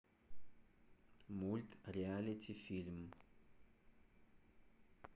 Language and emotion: Russian, neutral